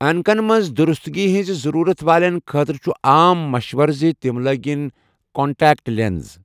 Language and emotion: Kashmiri, neutral